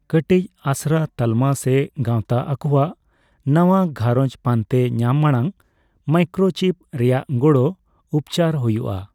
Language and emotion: Santali, neutral